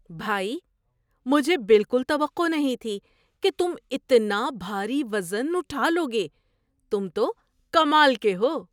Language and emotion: Urdu, surprised